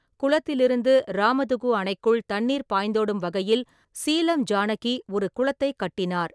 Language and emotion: Tamil, neutral